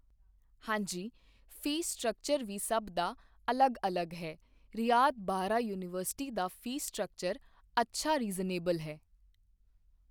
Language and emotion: Punjabi, neutral